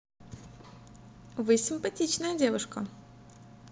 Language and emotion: Russian, positive